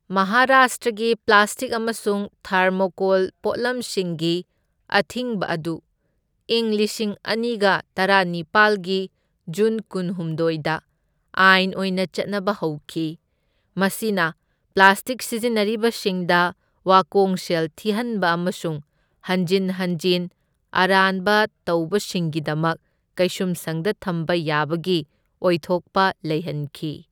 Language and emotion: Manipuri, neutral